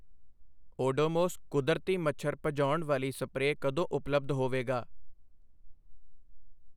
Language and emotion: Punjabi, neutral